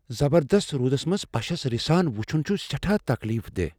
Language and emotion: Kashmiri, fearful